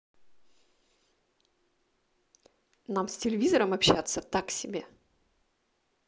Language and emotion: Russian, neutral